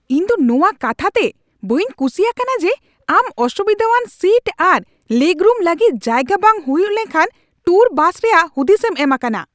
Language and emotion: Santali, angry